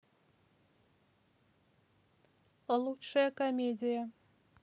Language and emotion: Russian, neutral